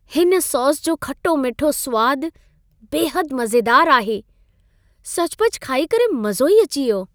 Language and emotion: Sindhi, happy